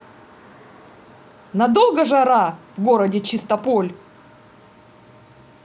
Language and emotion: Russian, angry